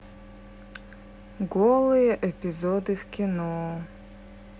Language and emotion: Russian, sad